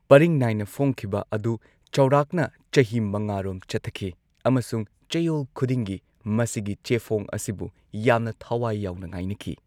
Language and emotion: Manipuri, neutral